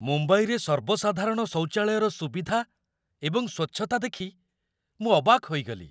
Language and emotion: Odia, surprised